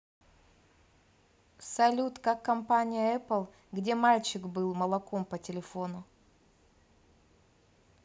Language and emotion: Russian, neutral